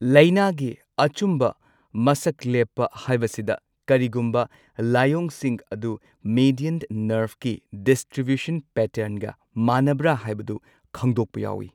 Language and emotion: Manipuri, neutral